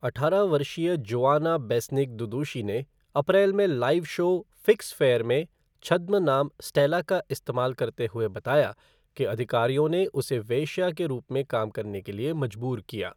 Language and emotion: Hindi, neutral